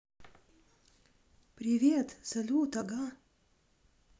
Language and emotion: Russian, positive